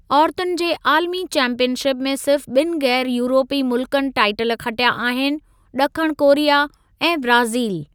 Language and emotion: Sindhi, neutral